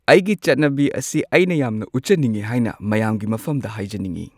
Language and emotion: Manipuri, neutral